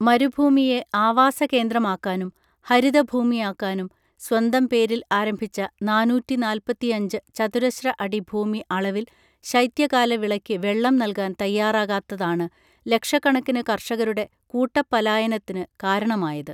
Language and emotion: Malayalam, neutral